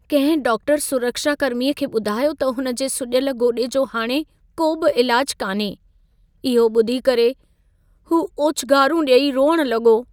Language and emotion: Sindhi, sad